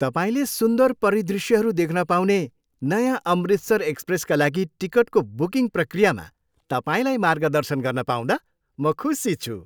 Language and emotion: Nepali, happy